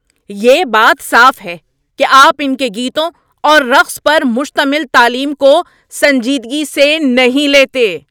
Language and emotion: Urdu, angry